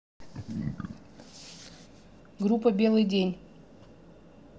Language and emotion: Russian, neutral